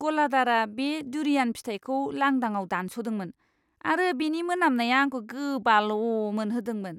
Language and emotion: Bodo, disgusted